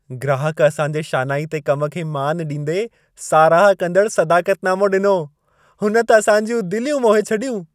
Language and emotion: Sindhi, happy